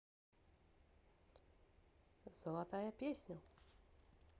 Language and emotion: Russian, positive